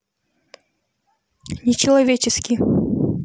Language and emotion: Russian, neutral